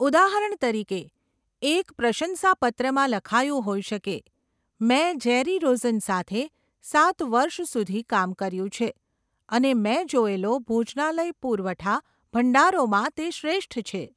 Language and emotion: Gujarati, neutral